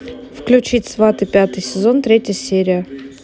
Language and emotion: Russian, neutral